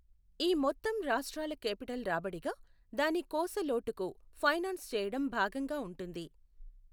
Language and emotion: Telugu, neutral